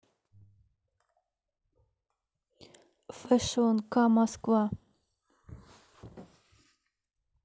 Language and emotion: Russian, neutral